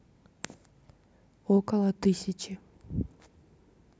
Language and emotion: Russian, neutral